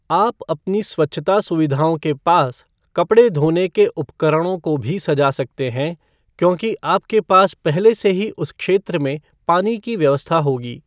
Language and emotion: Hindi, neutral